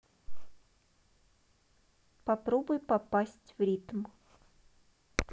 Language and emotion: Russian, neutral